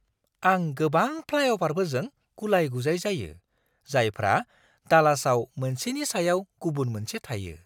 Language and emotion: Bodo, surprised